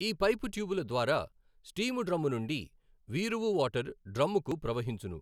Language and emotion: Telugu, neutral